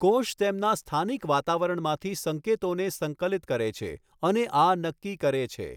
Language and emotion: Gujarati, neutral